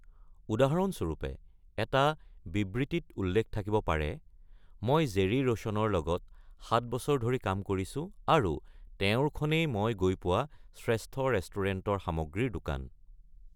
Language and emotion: Assamese, neutral